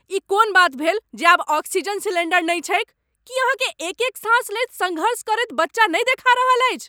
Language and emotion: Maithili, angry